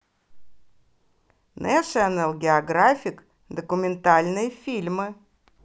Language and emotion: Russian, positive